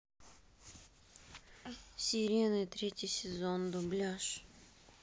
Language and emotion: Russian, neutral